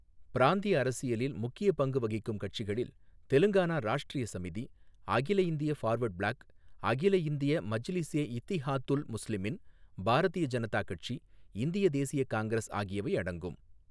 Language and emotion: Tamil, neutral